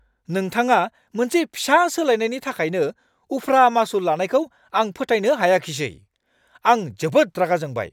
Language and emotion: Bodo, angry